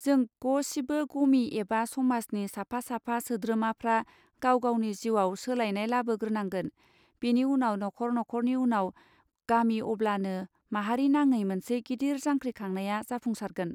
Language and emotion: Bodo, neutral